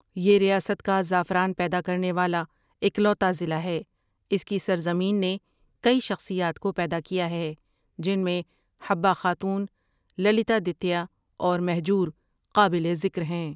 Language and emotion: Urdu, neutral